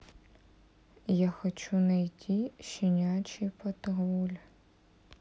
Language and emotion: Russian, sad